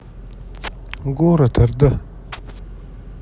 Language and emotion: Russian, neutral